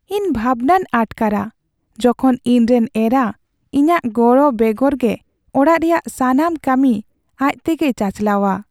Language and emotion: Santali, sad